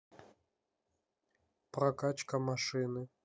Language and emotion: Russian, neutral